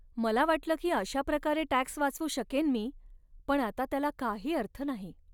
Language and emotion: Marathi, sad